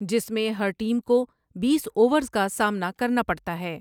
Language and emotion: Urdu, neutral